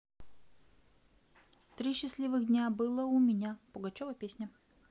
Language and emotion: Russian, neutral